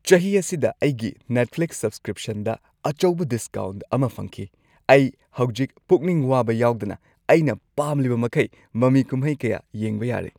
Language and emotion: Manipuri, happy